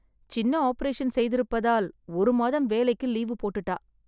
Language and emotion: Tamil, sad